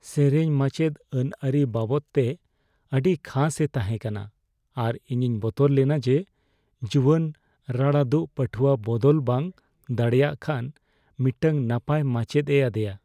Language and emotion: Santali, fearful